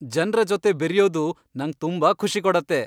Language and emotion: Kannada, happy